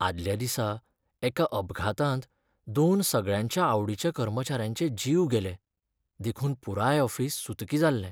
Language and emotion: Goan Konkani, sad